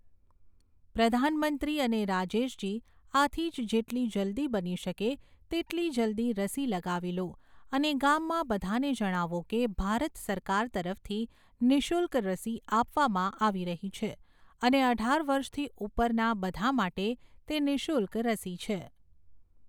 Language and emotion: Gujarati, neutral